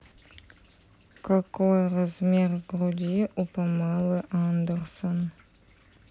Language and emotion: Russian, neutral